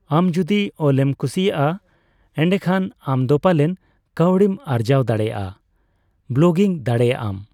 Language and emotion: Santali, neutral